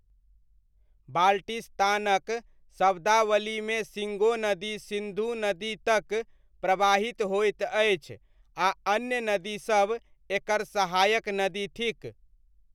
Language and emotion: Maithili, neutral